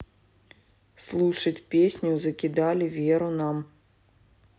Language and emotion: Russian, neutral